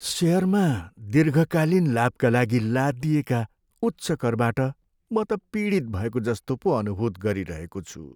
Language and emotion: Nepali, sad